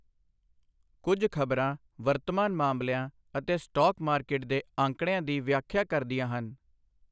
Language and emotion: Punjabi, neutral